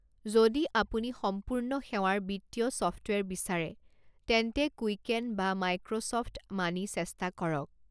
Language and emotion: Assamese, neutral